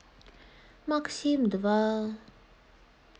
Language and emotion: Russian, sad